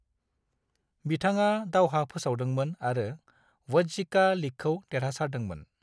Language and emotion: Bodo, neutral